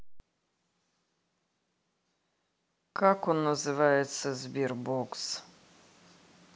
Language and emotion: Russian, neutral